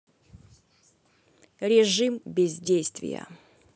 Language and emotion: Russian, neutral